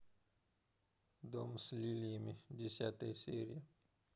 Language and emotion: Russian, neutral